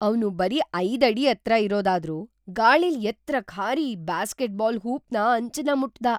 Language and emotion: Kannada, surprised